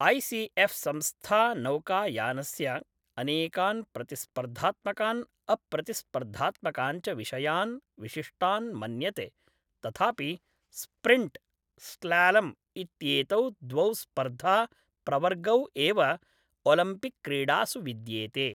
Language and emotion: Sanskrit, neutral